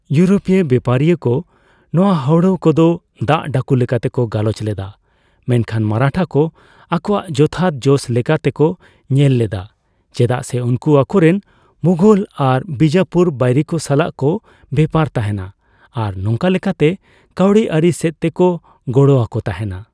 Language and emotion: Santali, neutral